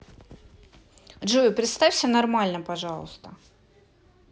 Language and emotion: Russian, neutral